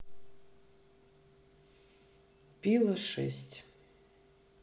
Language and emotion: Russian, neutral